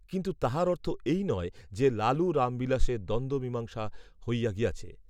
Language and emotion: Bengali, neutral